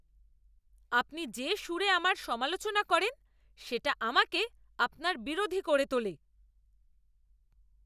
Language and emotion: Bengali, angry